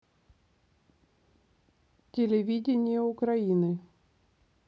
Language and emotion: Russian, neutral